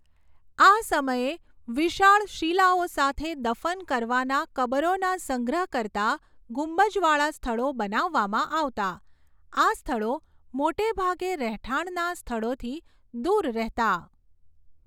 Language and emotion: Gujarati, neutral